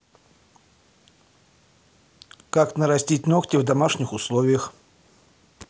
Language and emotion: Russian, neutral